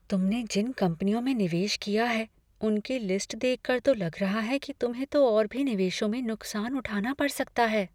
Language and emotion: Hindi, fearful